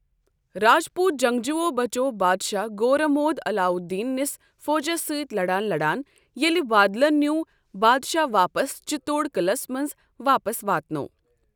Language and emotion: Kashmiri, neutral